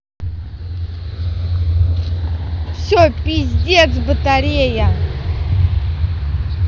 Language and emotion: Russian, angry